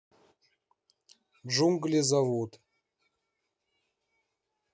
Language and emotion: Russian, neutral